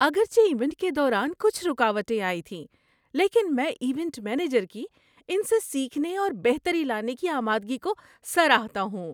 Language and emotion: Urdu, happy